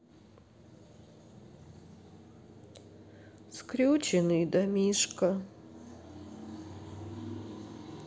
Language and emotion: Russian, sad